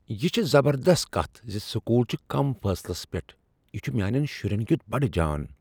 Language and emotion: Kashmiri, surprised